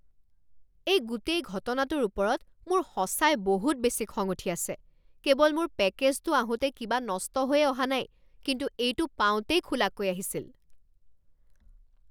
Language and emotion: Assamese, angry